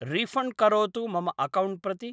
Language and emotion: Sanskrit, neutral